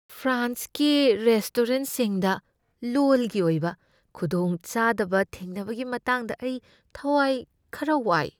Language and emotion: Manipuri, fearful